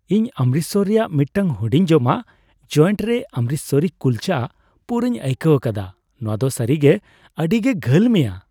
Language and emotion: Santali, happy